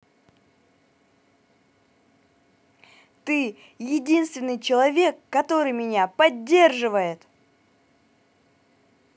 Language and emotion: Russian, positive